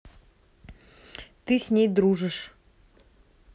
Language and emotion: Russian, neutral